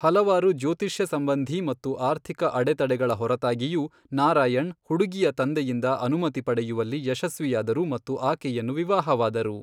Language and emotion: Kannada, neutral